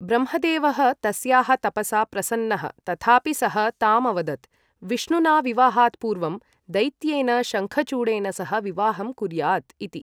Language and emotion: Sanskrit, neutral